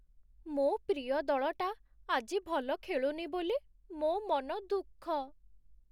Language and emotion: Odia, sad